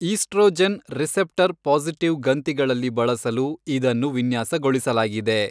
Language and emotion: Kannada, neutral